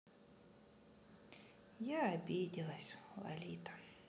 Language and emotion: Russian, sad